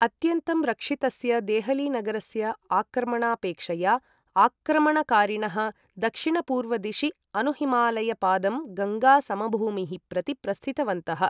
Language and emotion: Sanskrit, neutral